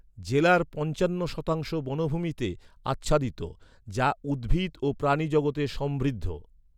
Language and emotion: Bengali, neutral